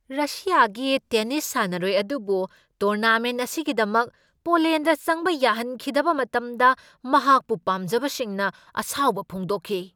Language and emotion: Manipuri, angry